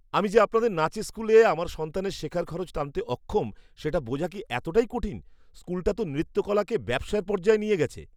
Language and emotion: Bengali, disgusted